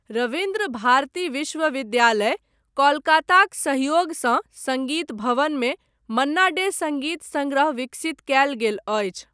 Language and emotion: Maithili, neutral